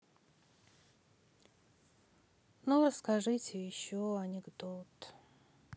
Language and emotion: Russian, sad